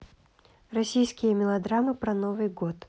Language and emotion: Russian, neutral